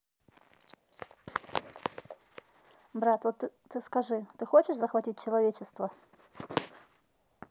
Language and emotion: Russian, neutral